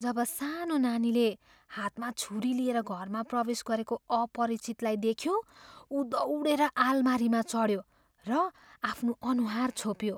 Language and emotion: Nepali, fearful